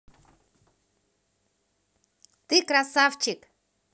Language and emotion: Russian, positive